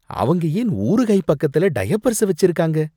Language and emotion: Tamil, disgusted